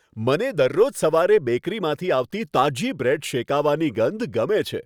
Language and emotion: Gujarati, happy